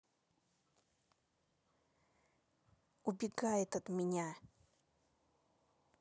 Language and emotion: Russian, angry